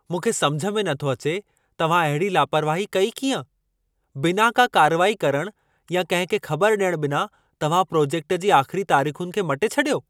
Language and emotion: Sindhi, angry